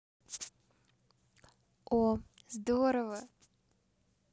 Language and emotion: Russian, positive